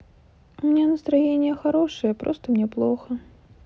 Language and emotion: Russian, sad